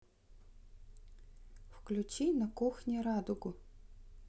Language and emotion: Russian, neutral